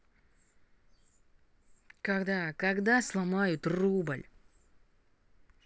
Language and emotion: Russian, angry